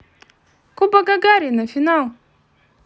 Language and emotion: Russian, positive